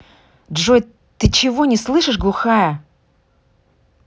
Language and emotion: Russian, angry